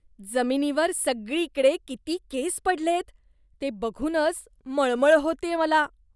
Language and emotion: Marathi, disgusted